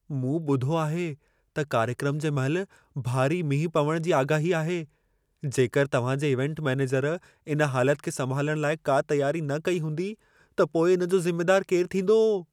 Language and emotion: Sindhi, fearful